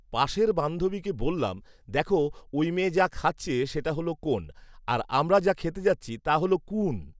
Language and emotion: Bengali, neutral